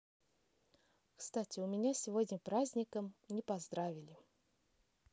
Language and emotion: Russian, neutral